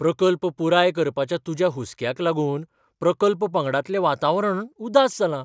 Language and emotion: Goan Konkani, surprised